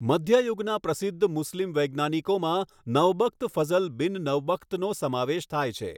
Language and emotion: Gujarati, neutral